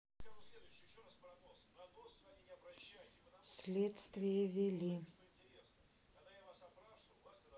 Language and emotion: Russian, sad